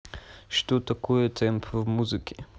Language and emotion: Russian, neutral